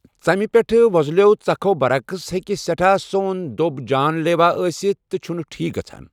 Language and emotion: Kashmiri, neutral